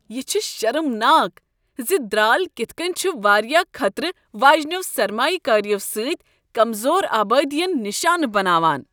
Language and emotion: Kashmiri, disgusted